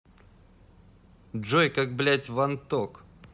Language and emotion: Russian, angry